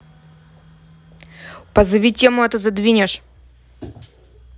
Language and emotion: Russian, angry